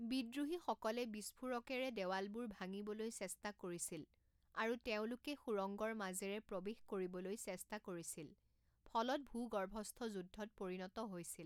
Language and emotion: Assamese, neutral